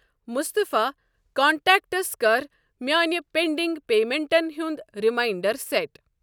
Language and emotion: Kashmiri, neutral